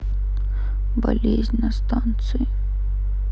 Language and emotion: Russian, sad